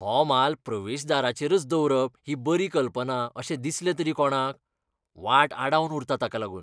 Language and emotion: Goan Konkani, disgusted